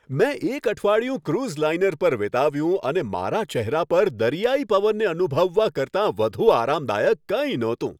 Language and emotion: Gujarati, happy